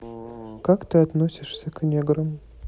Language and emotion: Russian, neutral